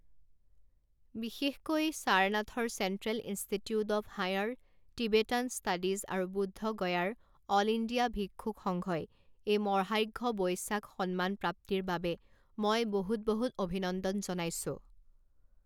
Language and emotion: Assamese, neutral